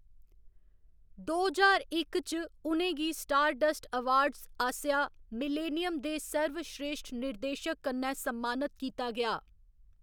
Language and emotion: Dogri, neutral